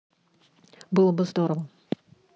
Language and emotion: Russian, neutral